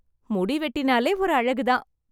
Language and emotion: Tamil, happy